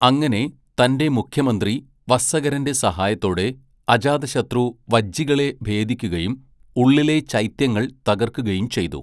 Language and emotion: Malayalam, neutral